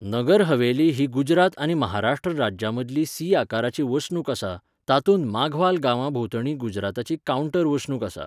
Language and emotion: Goan Konkani, neutral